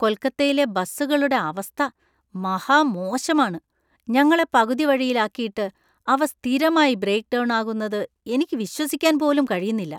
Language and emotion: Malayalam, disgusted